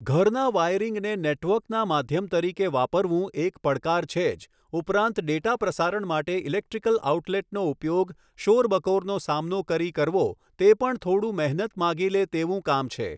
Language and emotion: Gujarati, neutral